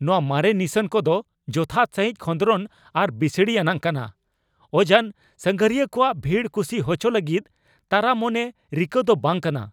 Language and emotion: Santali, angry